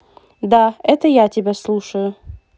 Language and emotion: Russian, positive